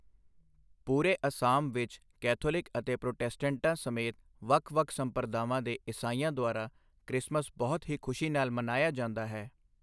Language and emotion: Punjabi, neutral